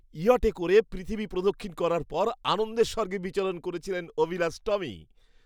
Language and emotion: Bengali, happy